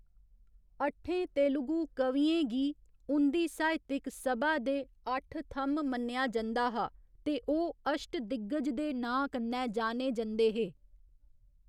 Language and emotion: Dogri, neutral